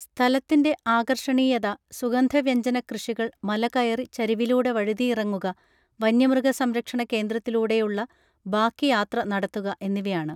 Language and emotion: Malayalam, neutral